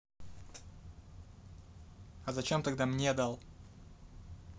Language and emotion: Russian, neutral